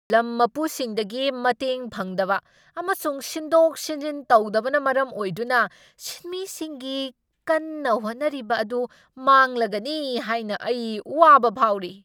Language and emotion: Manipuri, angry